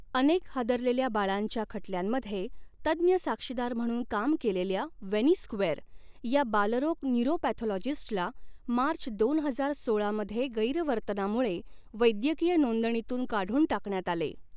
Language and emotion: Marathi, neutral